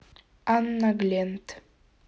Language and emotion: Russian, neutral